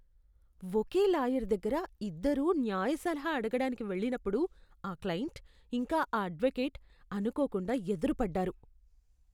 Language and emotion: Telugu, disgusted